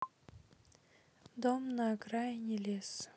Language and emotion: Russian, sad